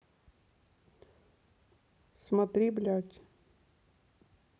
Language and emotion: Russian, neutral